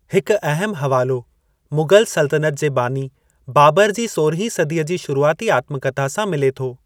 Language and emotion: Sindhi, neutral